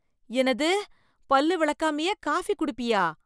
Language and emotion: Tamil, disgusted